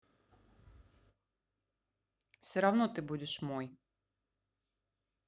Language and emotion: Russian, neutral